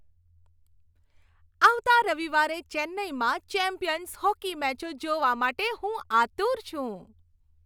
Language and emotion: Gujarati, happy